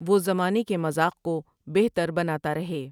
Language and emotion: Urdu, neutral